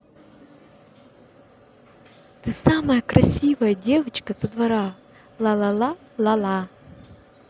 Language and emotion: Russian, positive